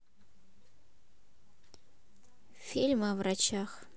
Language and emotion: Russian, neutral